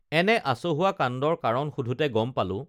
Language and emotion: Assamese, neutral